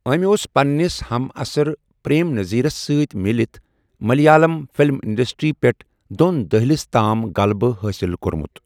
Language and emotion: Kashmiri, neutral